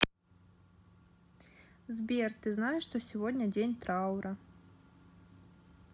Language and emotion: Russian, sad